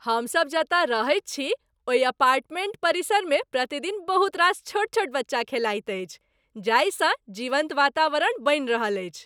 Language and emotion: Maithili, happy